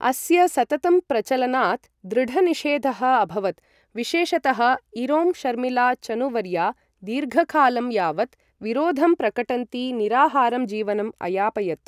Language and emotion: Sanskrit, neutral